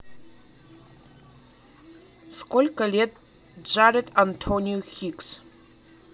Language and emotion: Russian, neutral